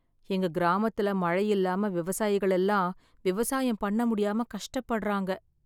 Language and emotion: Tamil, sad